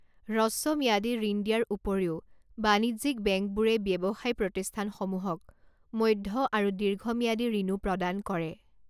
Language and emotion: Assamese, neutral